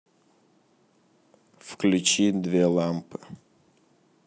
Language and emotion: Russian, neutral